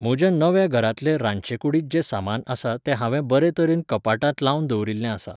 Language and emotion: Goan Konkani, neutral